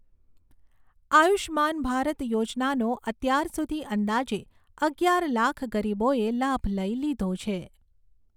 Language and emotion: Gujarati, neutral